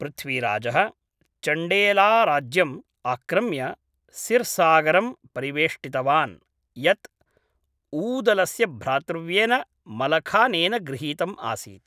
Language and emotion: Sanskrit, neutral